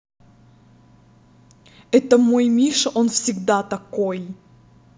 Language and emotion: Russian, angry